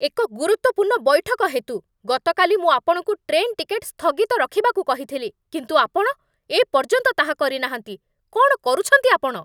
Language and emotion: Odia, angry